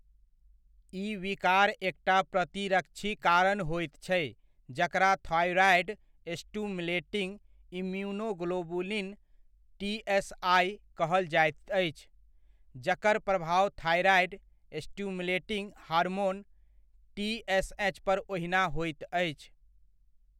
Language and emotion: Maithili, neutral